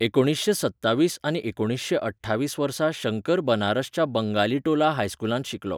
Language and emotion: Goan Konkani, neutral